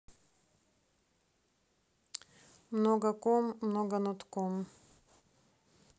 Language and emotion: Russian, neutral